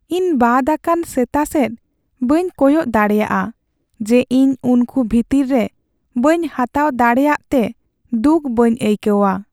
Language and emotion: Santali, sad